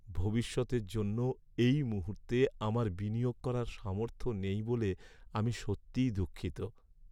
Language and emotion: Bengali, sad